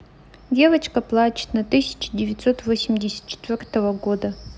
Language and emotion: Russian, sad